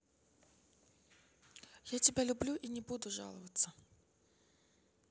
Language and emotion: Russian, neutral